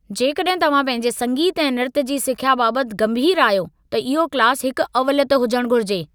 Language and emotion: Sindhi, angry